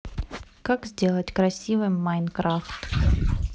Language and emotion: Russian, neutral